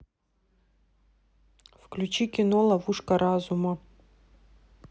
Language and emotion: Russian, neutral